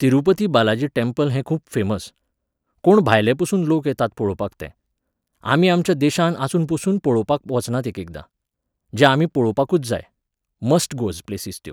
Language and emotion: Goan Konkani, neutral